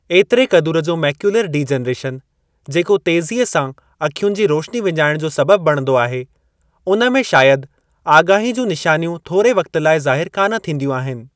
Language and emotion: Sindhi, neutral